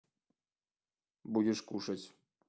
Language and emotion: Russian, neutral